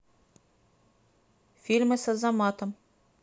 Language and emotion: Russian, neutral